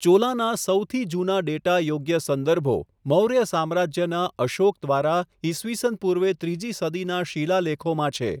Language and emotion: Gujarati, neutral